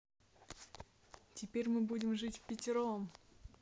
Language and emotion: Russian, positive